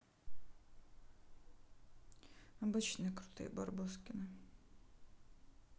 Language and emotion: Russian, neutral